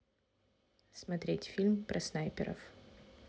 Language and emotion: Russian, neutral